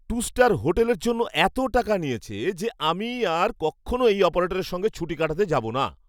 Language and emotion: Bengali, angry